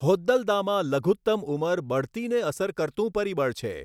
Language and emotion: Gujarati, neutral